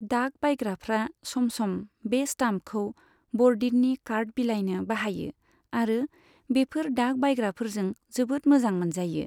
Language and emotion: Bodo, neutral